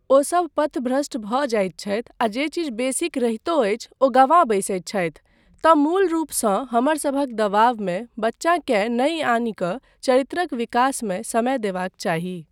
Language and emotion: Maithili, neutral